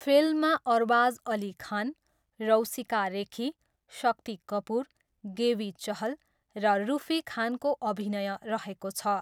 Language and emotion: Nepali, neutral